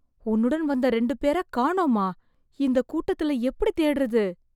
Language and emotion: Tamil, fearful